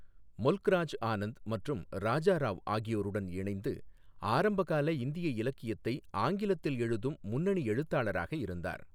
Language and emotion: Tamil, neutral